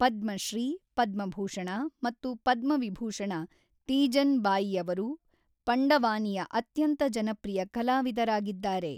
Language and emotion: Kannada, neutral